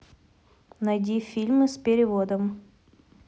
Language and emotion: Russian, neutral